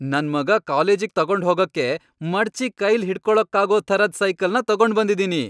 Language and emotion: Kannada, happy